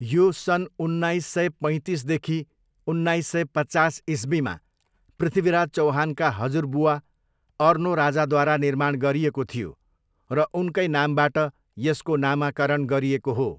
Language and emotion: Nepali, neutral